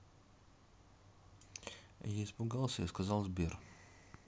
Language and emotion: Russian, neutral